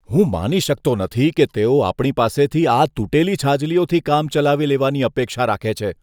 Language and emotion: Gujarati, disgusted